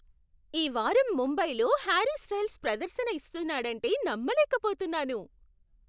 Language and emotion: Telugu, surprised